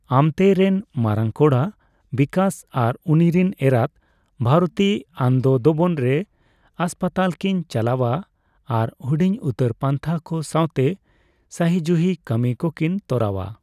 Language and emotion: Santali, neutral